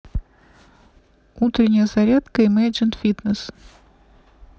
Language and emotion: Russian, neutral